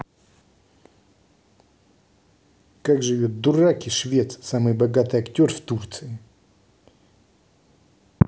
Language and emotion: Russian, angry